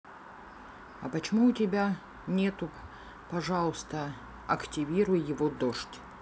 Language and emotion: Russian, neutral